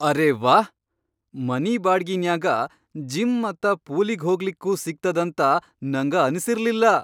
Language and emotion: Kannada, surprised